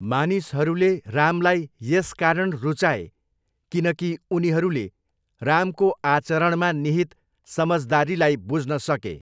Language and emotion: Nepali, neutral